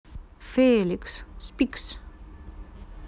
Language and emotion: Russian, neutral